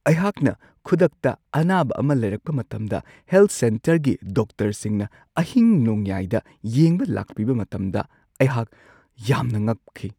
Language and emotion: Manipuri, surprised